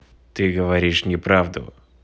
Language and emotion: Russian, neutral